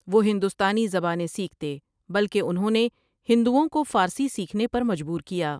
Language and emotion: Urdu, neutral